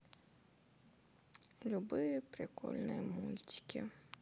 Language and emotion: Russian, sad